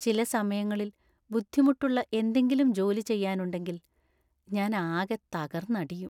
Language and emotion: Malayalam, sad